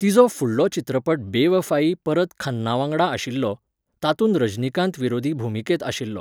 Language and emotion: Goan Konkani, neutral